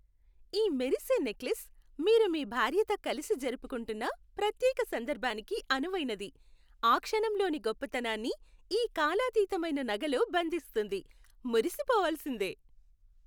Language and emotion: Telugu, happy